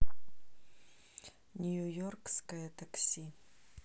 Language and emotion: Russian, neutral